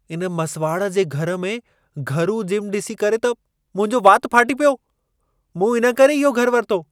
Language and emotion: Sindhi, surprised